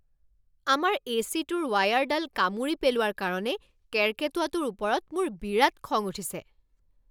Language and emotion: Assamese, angry